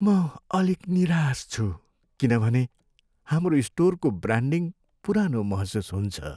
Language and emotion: Nepali, sad